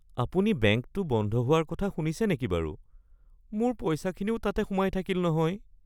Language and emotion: Assamese, sad